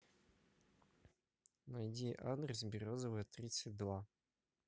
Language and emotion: Russian, neutral